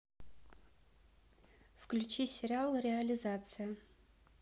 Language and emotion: Russian, neutral